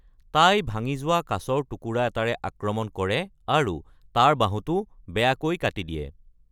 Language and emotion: Assamese, neutral